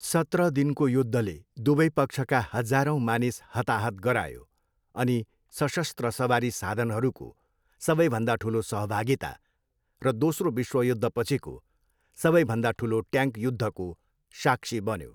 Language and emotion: Nepali, neutral